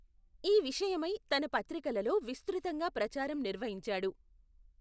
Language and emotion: Telugu, neutral